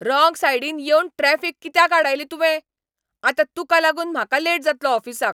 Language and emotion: Goan Konkani, angry